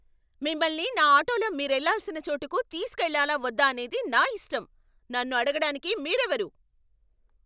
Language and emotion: Telugu, angry